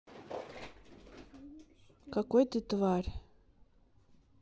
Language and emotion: Russian, neutral